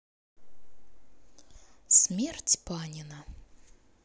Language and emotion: Russian, neutral